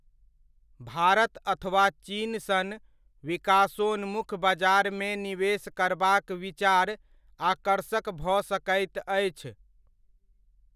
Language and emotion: Maithili, neutral